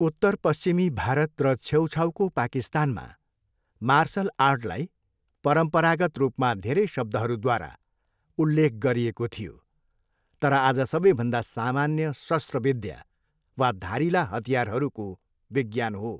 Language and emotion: Nepali, neutral